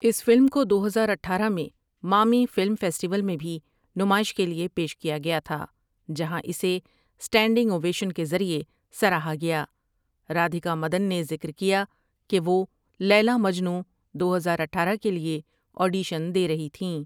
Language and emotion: Urdu, neutral